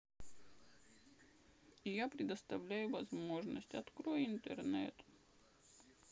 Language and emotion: Russian, sad